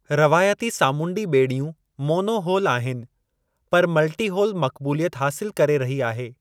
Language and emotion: Sindhi, neutral